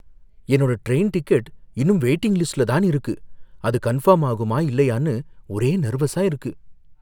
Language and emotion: Tamil, fearful